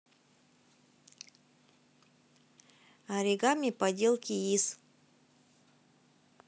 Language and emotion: Russian, neutral